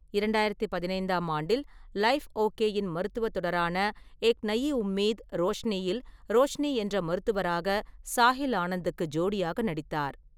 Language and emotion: Tamil, neutral